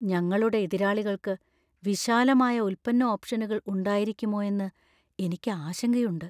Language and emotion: Malayalam, fearful